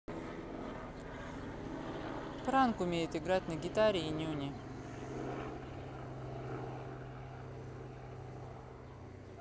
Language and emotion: Russian, neutral